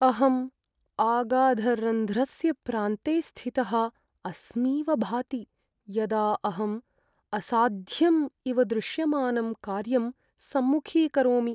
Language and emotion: Sanskrit, sad